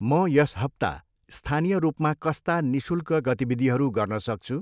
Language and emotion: Nepali, neutral